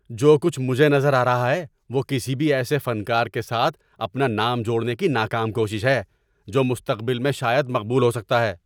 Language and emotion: Urdu, angry